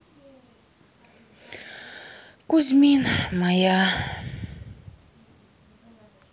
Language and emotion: Russian, sad